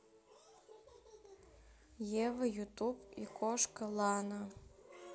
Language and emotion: Russian, neutral